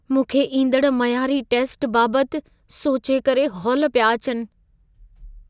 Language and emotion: Sindhi, fearful